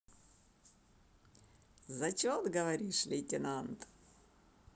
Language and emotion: Russian, positive